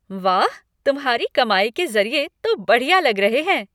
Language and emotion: Hindi, happy